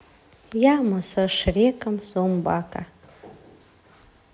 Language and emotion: Russian, neutral